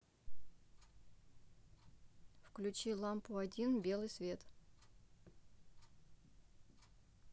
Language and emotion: Russian, neutral